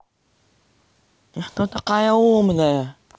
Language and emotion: Russian, angry